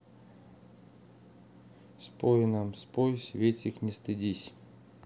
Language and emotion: Russian, neutral